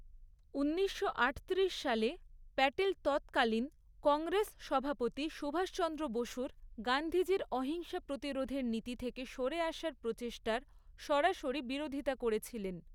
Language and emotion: Bengali, neutral